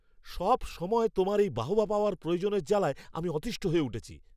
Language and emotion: Bengali, angry